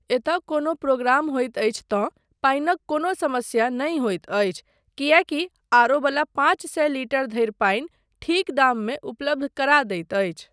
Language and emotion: Maithili, neutral